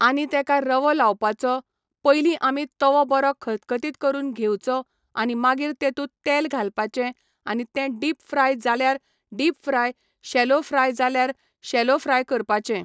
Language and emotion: Goan Konkani, neutral